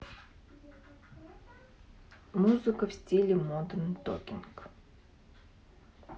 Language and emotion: Russian, neutral